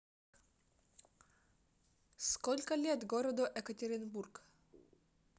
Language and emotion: Russian, neutral